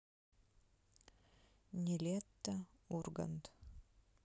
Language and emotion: Russian, neutral